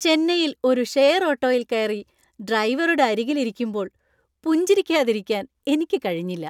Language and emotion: Malayalam, happy